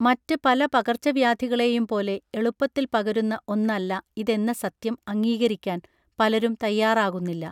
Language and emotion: Malayalam, neutral